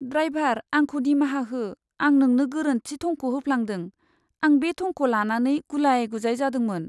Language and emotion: Bodo, sad